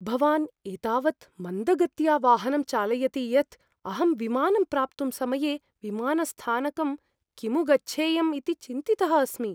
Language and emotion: Sanskrit, fearful